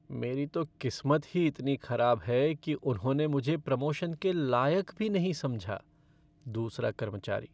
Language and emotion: Hindi, sad